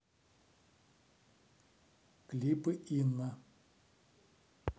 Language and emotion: Russian, neutral